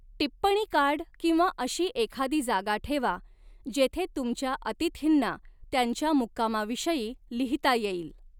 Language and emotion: Marathi, neutral